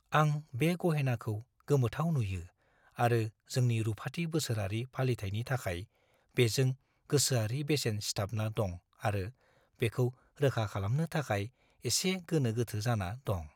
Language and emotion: Bodo, fearful